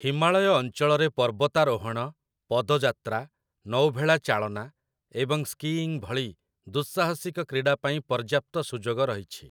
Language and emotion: Odia, neutral